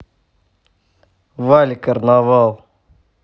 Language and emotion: Russian, neutral